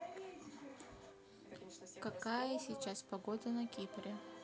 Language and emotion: Russian, neutral